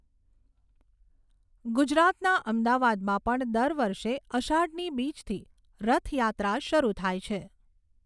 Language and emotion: Gujarati, neutral